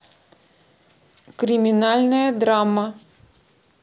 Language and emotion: Russian, neutral